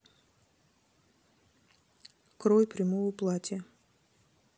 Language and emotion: Russian, neutral